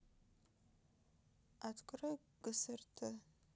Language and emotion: Russian, sad